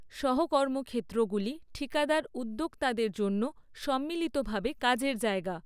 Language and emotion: Bengali, neutral